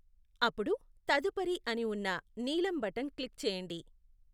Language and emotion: Telugu, neutral